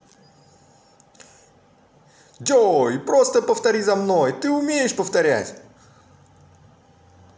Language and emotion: Russian, positive